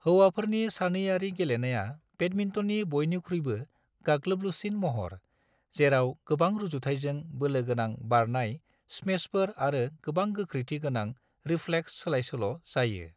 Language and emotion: Bodo, neutral